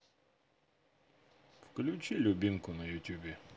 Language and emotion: Russian, neutral